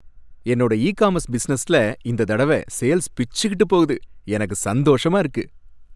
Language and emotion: Tamil, happy